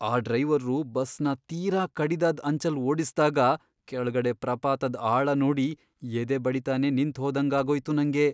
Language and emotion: Kannada, fearful